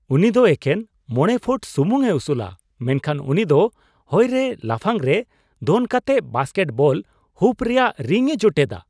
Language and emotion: Santali, surprised